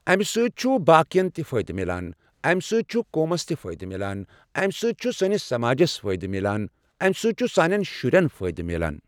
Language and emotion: Kashmiri, neutral